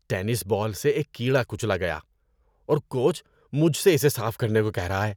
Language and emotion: Urdu, disgusted